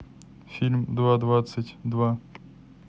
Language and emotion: Russian, neutral